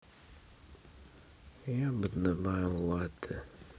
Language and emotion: Russian, neutral